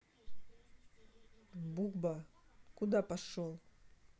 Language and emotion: Russian, angry